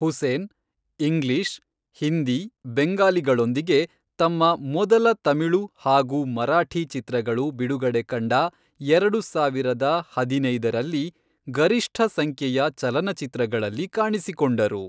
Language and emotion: Kannada, neutral